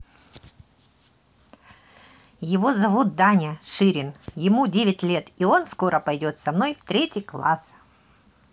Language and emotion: Russian, positive